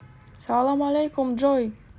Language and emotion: Russian, positive